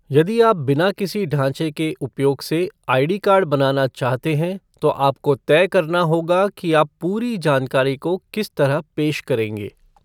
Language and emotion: Hindi, neutral